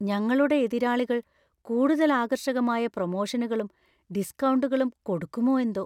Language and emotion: Malayalam, fearful